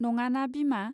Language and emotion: Bodo, neutral